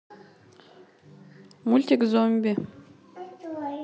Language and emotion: Russian, neutral